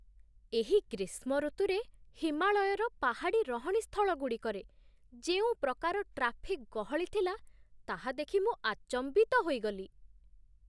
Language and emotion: Odia, surprised